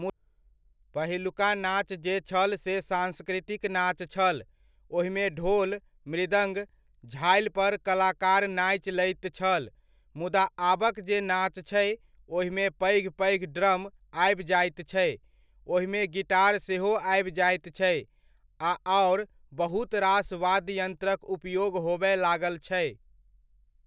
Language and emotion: Maithili, neutral